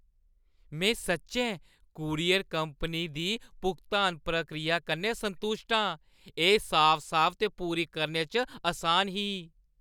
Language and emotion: Dogri, happy